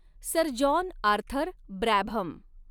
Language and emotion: Marathi, neutral